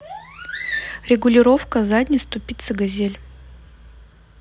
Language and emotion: Russian, neutral